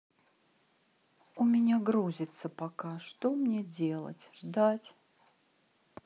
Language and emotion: Russian, sad